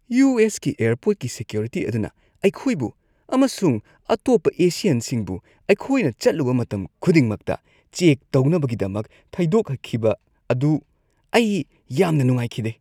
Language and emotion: Manipuri, disgusted